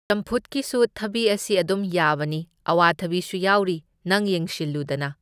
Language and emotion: Manipuri, neutral